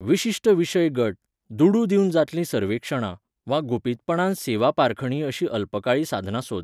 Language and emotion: Goan Konkani, neutral